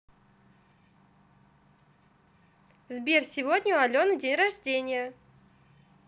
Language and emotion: Russian, positive